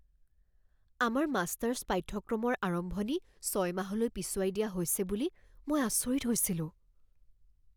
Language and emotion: Assamese, fearful